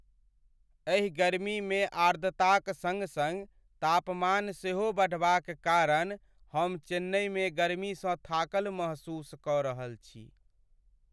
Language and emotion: Maithili, sad